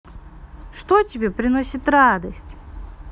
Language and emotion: Russian, positive